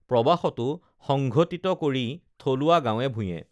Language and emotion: Assamese, neutral